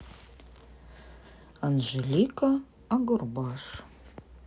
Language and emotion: Russian, neutral